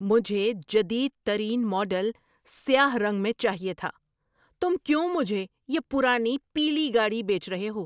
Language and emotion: Urdu, angry